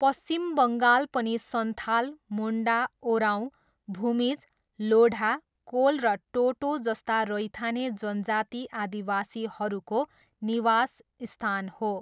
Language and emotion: Nepali, neutral